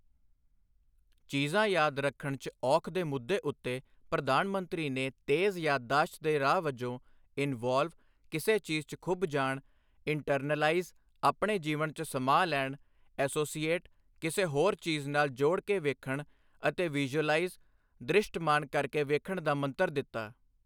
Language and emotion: Punjabi, neutral